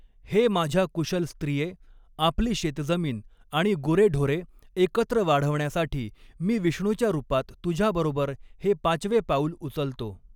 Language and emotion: Marathi, neutral